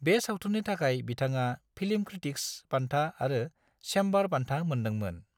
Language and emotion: Bodo, neutral